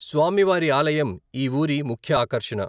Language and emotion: Telugu, neutral